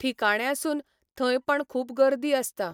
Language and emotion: Goan Konkani, neutral